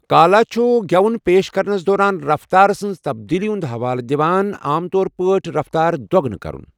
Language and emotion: Kashmiri, neutral